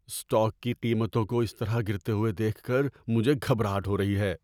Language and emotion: Urdu, fearful